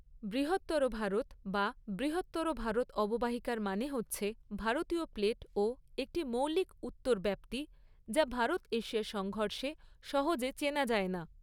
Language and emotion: Bengali, neutral